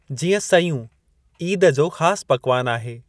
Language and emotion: Sindhi, neutral